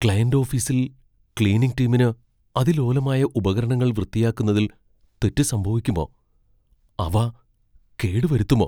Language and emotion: Malayalam, fearful